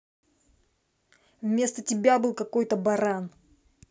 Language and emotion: Russian, angry